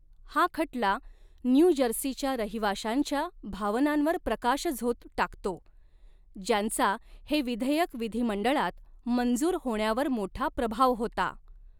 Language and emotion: Marathi, neutral